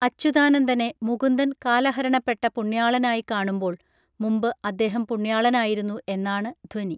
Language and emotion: Malayalam, neutral